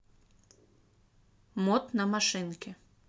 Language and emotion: Russian, neutral